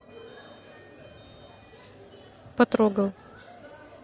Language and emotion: Russian, neutral